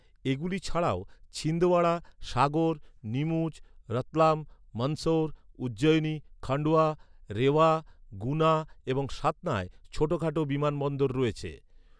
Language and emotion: Bengali, neutral